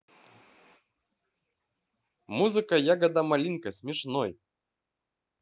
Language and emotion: Russian, positive